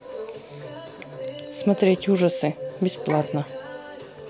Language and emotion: Russian, neutral